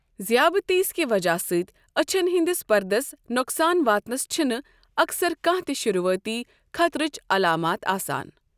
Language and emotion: Kashmiri, neutral